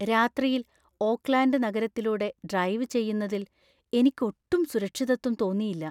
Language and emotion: Malayalam, fearful